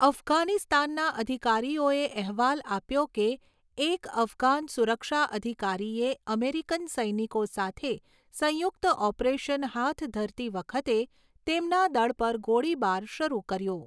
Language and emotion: Gujarati, neutral